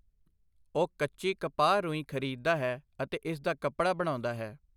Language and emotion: Punjabi, neutral